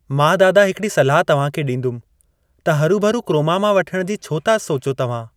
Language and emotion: Sindhi, neutral